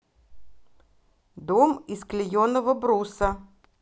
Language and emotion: Russian, neutral